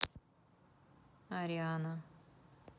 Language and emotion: Russian, neutral